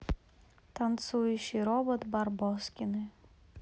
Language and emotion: Russian, sad